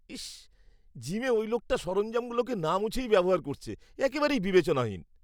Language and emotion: Bengali, disgusted